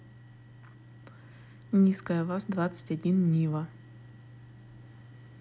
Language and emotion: Russian, neutral